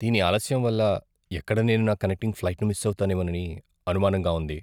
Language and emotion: Telugu, fearful